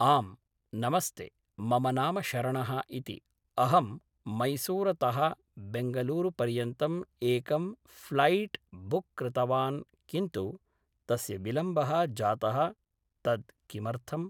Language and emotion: Sanskrit, neutral